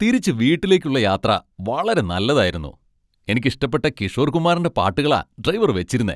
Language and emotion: Malayalam, happy